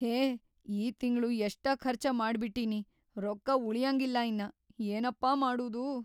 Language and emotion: Kannada, fearful